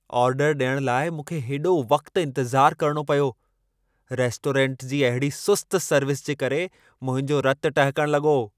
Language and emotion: Sindhi, angry